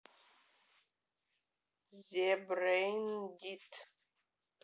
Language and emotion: Russian, neutral